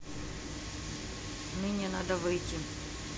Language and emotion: Russian, neutral